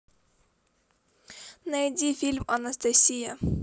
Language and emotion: Russian, neutral